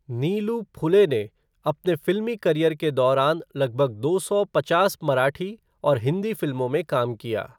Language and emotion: Hindi, neutral